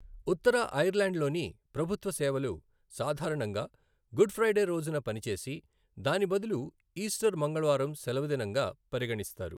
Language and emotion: Telugu, neutral